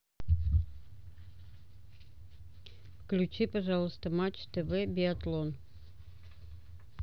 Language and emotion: Russian, neutral